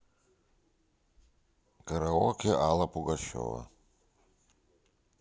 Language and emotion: Russian, neutral